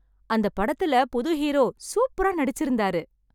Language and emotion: Tamil, happy